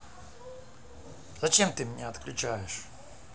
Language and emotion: Russian, angry